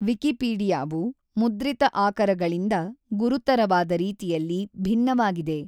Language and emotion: Kannada, neutral